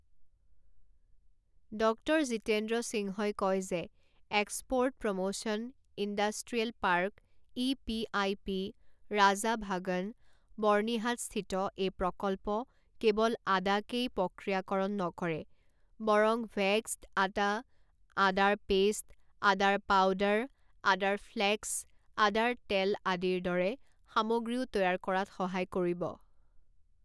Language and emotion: Assamese, neutral